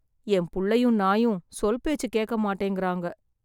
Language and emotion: Tamil, sad